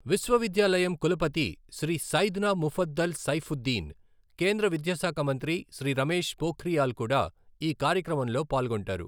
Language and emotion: Telugu, neutral